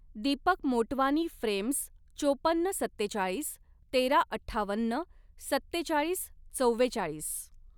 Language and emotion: Marathi, neutral